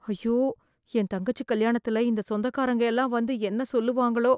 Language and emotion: Tamil, fearful